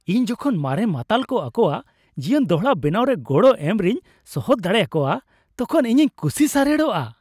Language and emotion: Santali, happy